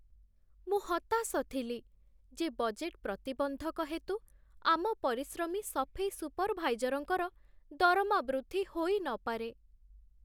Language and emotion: Odia, sad